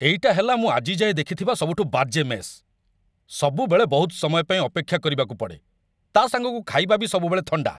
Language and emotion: Odia, angry